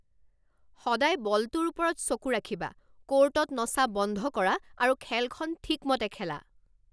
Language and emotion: Assamese, angry